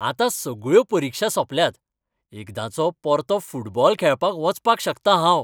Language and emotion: Goan Konkani, happy